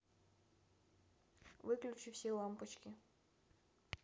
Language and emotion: Russian, neutral